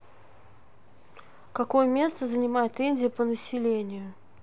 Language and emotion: Russian, neutral